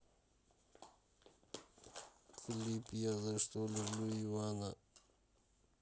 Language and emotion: Russian, neutral